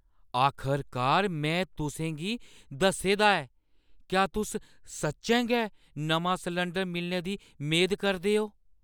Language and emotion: Dogri, surprised